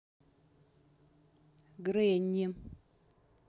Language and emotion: Russian, neutral